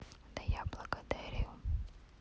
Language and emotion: Russian, neutral